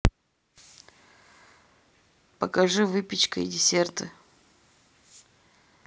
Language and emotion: Russian, neutral